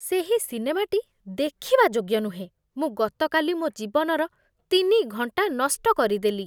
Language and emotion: Odia, disgusted